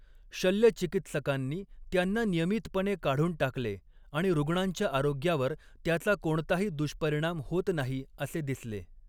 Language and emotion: Marathi, neutral